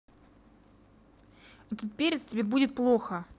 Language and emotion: Russian, angry